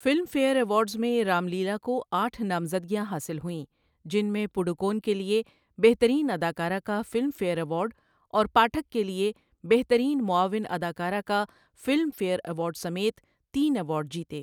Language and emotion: Urdu, neutral